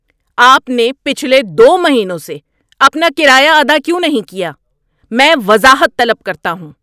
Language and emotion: Urdu, angry